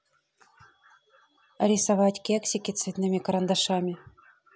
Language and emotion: Russian, neutral